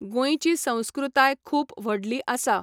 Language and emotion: Goan Konkani, neutral